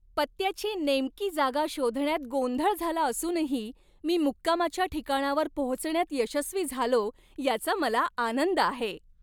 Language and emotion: Marathi, happy